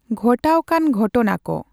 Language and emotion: Santali, neutral